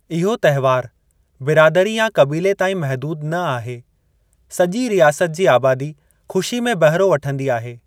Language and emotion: Sindhi, neutral